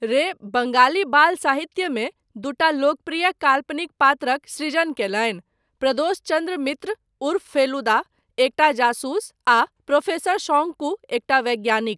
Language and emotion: Maithili, neutral